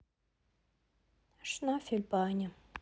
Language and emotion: Russian, sad